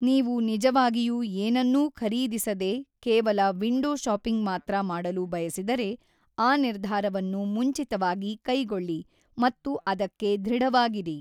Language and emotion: Kannada, neutral